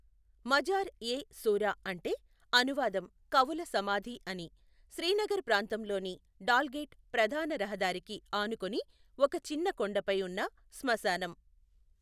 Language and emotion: Telugu, neutral